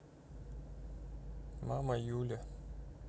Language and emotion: Russian, neutral